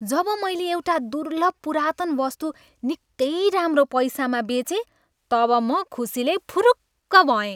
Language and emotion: Nepali, happy